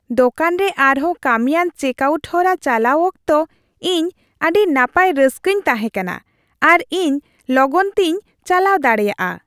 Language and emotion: Santali, happy